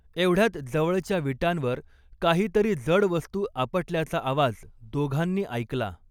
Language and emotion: Marathi, neutral